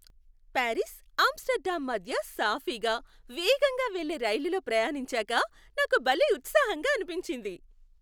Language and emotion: Telugu, happy